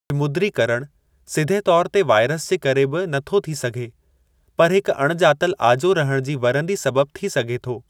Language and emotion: Sindhi, neutral